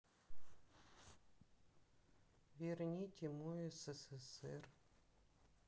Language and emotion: Russian, sad